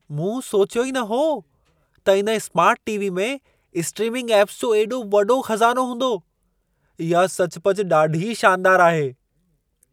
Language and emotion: Sindhi, surprised